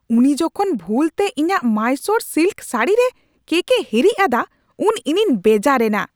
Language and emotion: Santali, angry